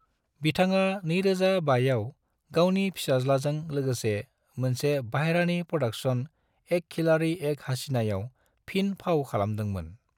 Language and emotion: Bodo, neutral